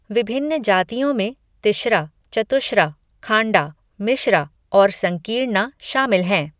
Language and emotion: Hindi, neutral